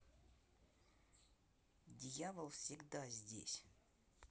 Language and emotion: Russian, neutral